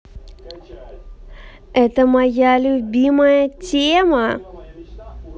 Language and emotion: Russian, positive